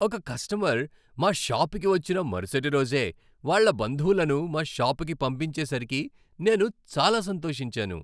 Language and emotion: Telugu, happy